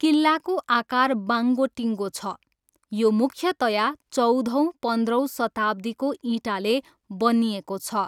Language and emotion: Nepali, neutral